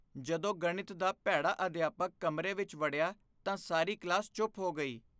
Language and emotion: Punjabi, fearful